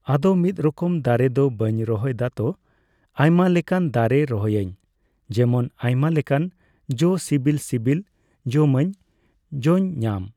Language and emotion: Santali, neutral